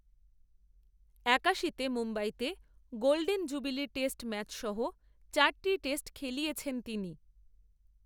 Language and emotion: Bengali, neutral